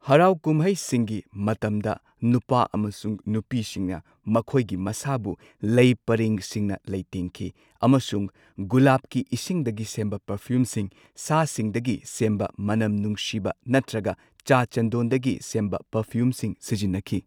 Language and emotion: Manipuri, neutral